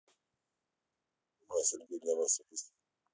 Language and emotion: Russian, neutral